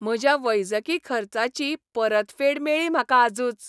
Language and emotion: Goan Konkani, happy